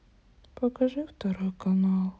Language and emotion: Russian, sad